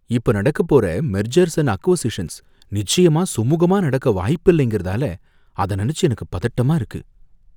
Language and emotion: Tamil, fearful